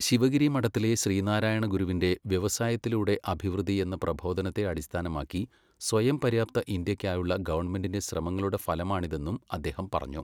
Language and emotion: Malayalam, neutral